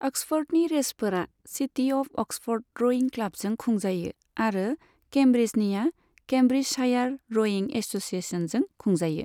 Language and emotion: Bodo, neutral